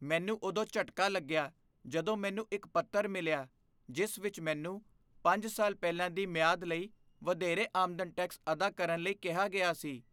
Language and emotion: Punjabi, fearful